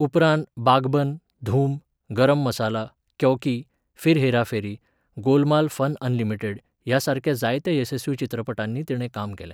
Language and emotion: Goan Konkani, neutral